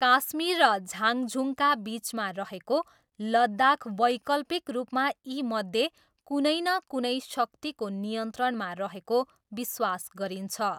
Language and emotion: Nepali, neutral